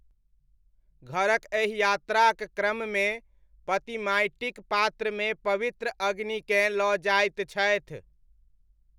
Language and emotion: Maithili, neutral